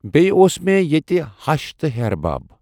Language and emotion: Kashmiri, neutral